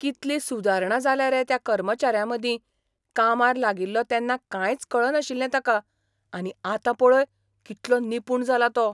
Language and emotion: Goan Konkani, surprised